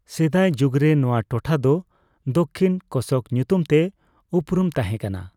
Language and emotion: Santali, neutral